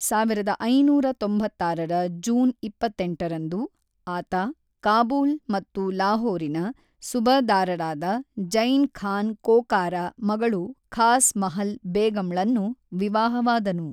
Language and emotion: Kannada, neutral